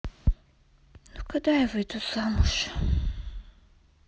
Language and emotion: Russian, sad